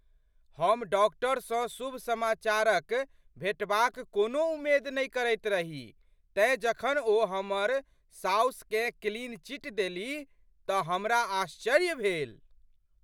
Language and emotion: Maithili, surprised